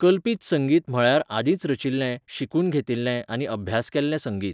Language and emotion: Goan Konkani, neutral